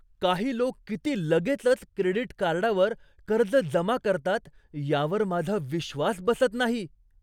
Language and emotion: Marathi, surprised